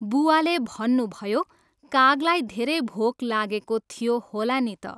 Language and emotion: Nepali, neutral